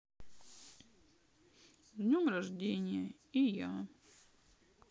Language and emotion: Russian, sad